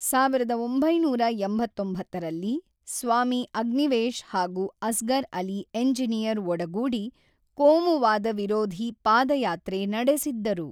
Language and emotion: Kannada, neutral